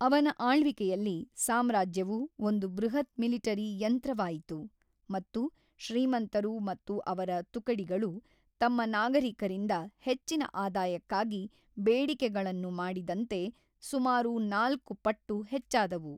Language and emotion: Kannada, neutral